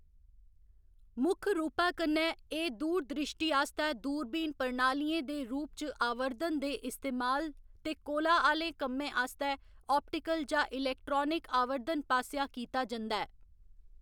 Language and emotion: Dogri, neutral